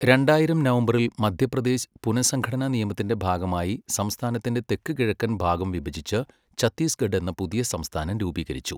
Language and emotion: Malayalam, neutral